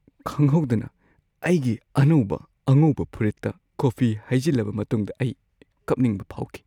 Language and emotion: Manipuri, sad